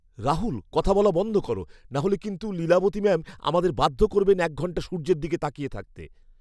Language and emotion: Bengali, fearful